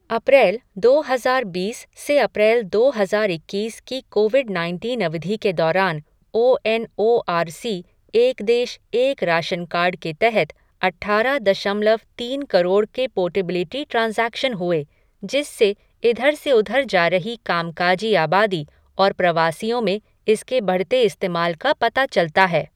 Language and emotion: Hindi, neutral